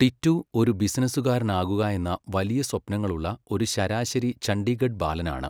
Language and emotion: Malayalam, neutral